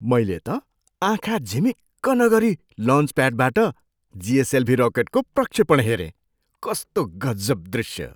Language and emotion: Nepali, surprised